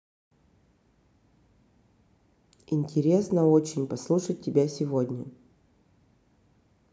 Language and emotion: Russian, neutral